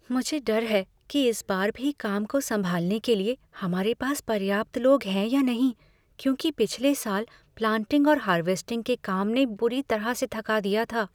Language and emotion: Hindi, fearful